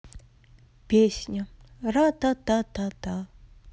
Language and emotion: Russian, sad